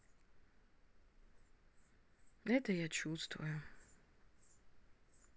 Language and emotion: Russian, sad